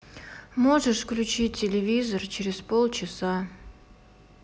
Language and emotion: Russian, sad